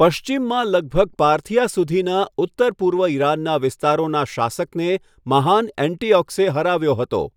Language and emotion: Gujarati, neutral